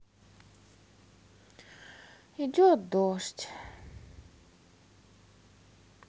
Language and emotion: Russian, sad